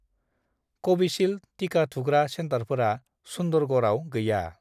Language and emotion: Bodo, neutral